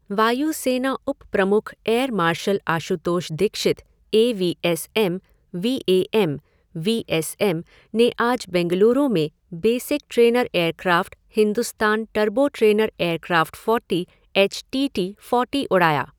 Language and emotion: Hindi, neutral